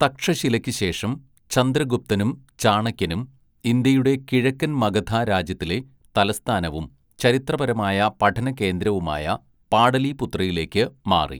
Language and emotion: Malayalam, neutral